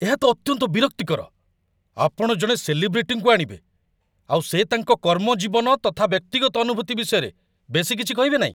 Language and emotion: Odia, angry